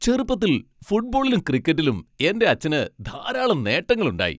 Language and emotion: Malayalam, happy